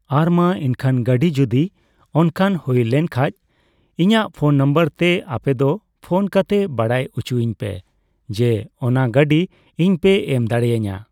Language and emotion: Santali, neutral